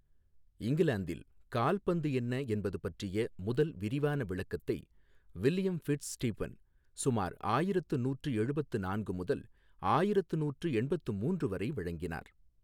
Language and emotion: Tamil, neutral